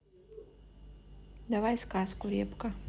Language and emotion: Russian, neutral